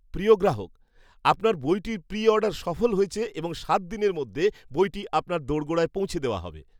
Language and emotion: Bengali, happy